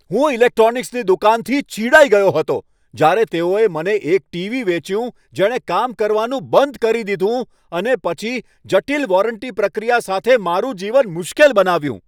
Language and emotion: Gujarati, angry